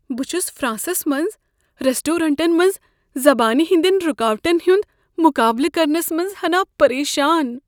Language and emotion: Kashmiri, fearful